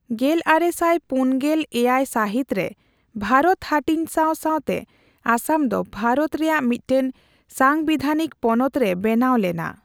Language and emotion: Santali, neutral